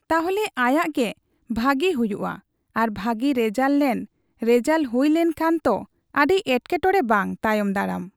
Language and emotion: Santali, neutral